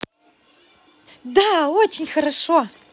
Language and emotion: Russian, positive